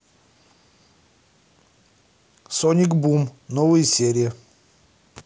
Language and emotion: Russian, neutral